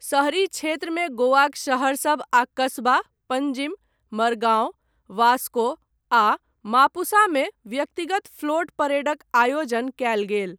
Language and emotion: Maithili, neutral